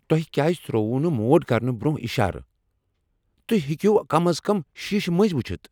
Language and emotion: Kashmiri, angry